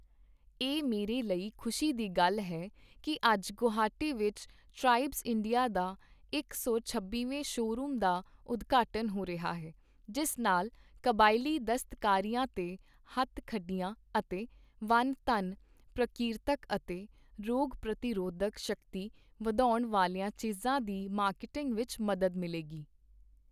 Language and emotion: Punjabi, neutral